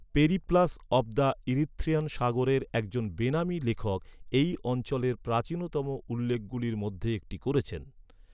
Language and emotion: Bengali, neutral